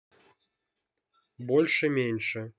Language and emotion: Russian, neutral